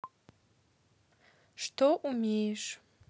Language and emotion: Russian, neutral